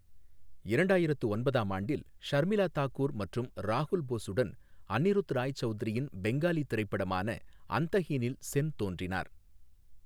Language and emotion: Tamil, neutral